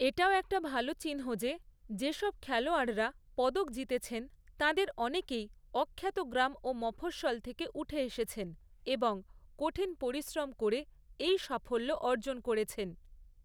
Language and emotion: Bengali, neutral